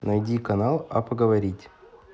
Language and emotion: Russian, neutral